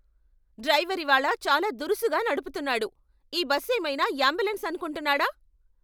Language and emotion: Telugu, angry